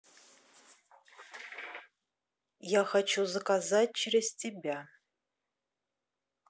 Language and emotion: Russian, neutral